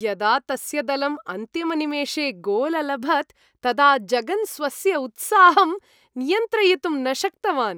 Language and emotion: Sanskrit, happy